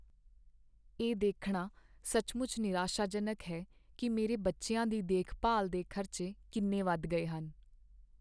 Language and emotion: Punjabi, sad